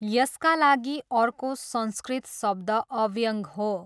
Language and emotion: Nepali, neutral